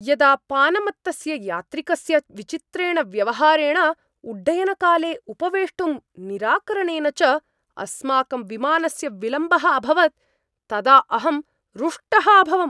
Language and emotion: Sanskrit, angry